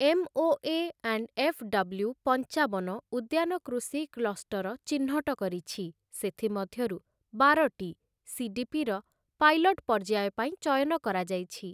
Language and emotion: Odia, neutral